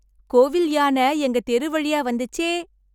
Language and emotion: Tamil, happy